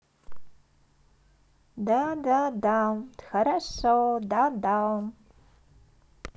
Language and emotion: Russian, positive